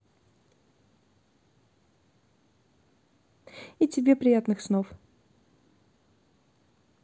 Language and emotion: Russian, positive